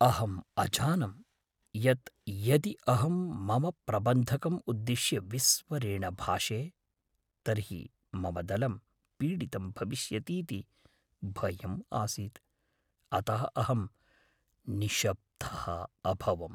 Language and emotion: Sanskrit, fearful